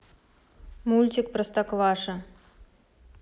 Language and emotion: Russian, neutral